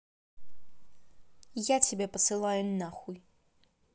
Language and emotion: Russian, angry